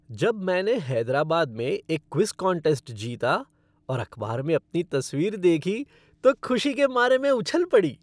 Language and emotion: Hindi, happy